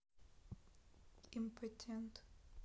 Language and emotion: Russian, neutral